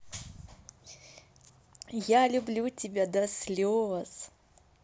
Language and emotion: Russian, positive